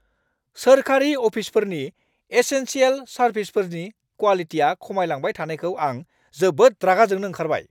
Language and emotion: Bodo, angry